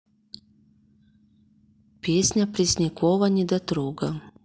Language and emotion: Russian, neutral